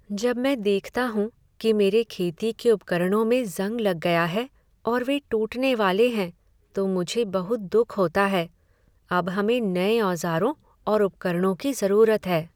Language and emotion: Hindi, sad